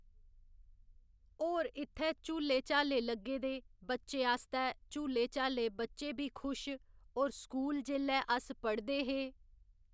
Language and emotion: Dogri, neutral